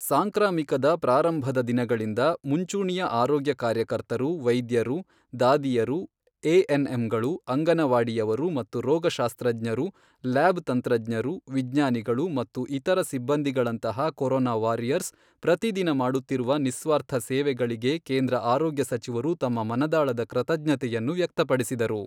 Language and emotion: Kannada, neutral